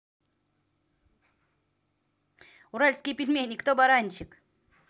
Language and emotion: Russian, positive